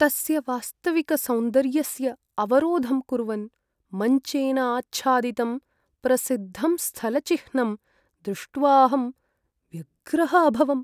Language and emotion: Sanskrit, sad